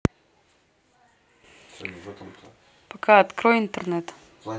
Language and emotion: Russian, neutral